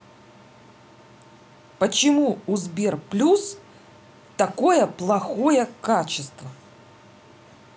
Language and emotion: Russian, angry